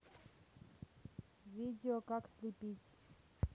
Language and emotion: Russian, neutral